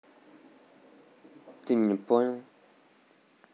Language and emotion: Russian, neutral